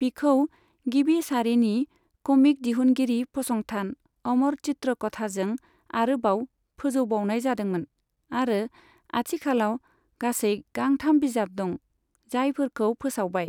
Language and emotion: Bodo, neutral